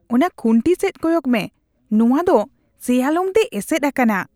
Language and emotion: Santali, disgusted